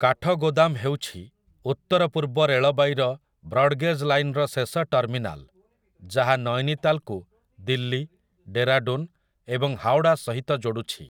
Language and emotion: Odia, neutral